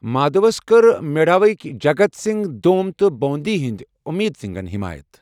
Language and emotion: Kashmiri, neutral